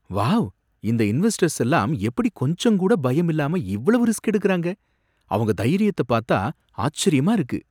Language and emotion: Tamil, surprised